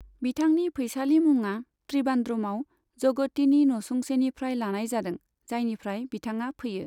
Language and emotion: Bodo, neutral